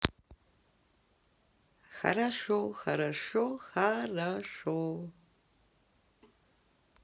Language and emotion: Russian, positive